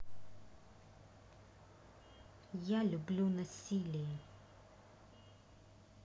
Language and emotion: Russian, neutral